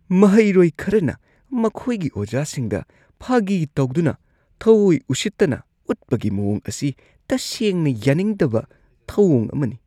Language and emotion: Manipuri, disgusted